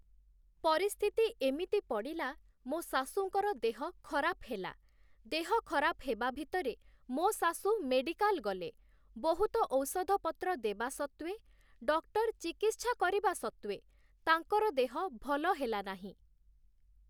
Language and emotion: Odia, neutral